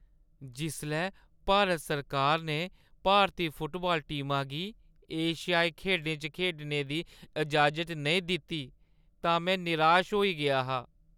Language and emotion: Dogri, sad